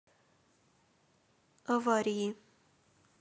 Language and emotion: Russian, neutral